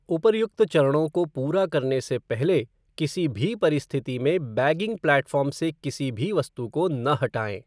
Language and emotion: Hindi, neutral